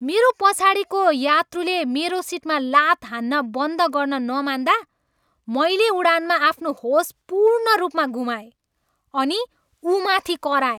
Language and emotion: Nepali, angry